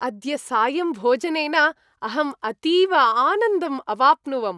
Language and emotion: Sanskrit, happy